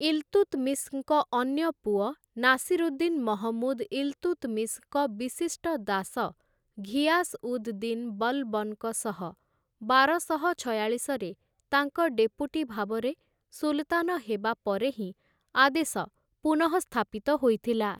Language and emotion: Odia, neutral